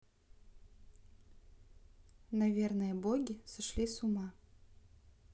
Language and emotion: Russian, neutral